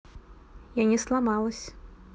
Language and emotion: Russian, neutral